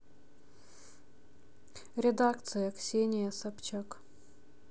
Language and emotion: Russian, neutral